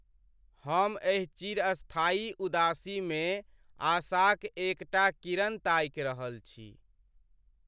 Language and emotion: Maithili, sad